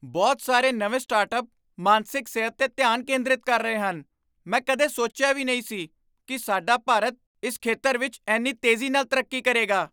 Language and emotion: Punjabi, surprised